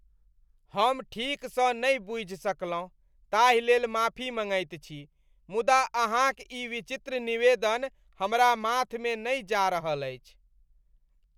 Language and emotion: Maithili, disgusted